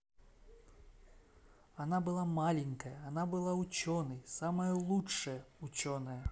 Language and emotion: Russian, positive